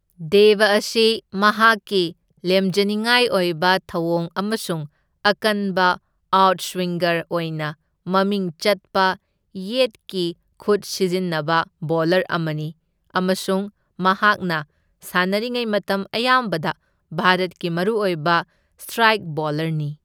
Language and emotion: Manipuri, neutral